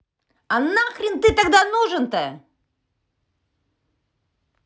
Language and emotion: Russian, angry